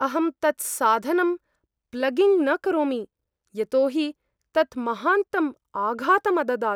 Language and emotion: Sanskrit, fearful